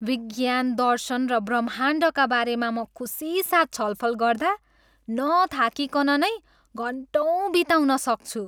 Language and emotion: Nepali, happy